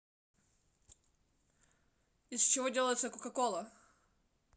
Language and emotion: Russian, neutral